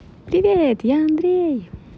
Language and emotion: Russian, positive